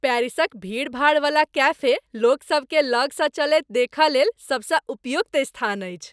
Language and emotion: Maithili, happy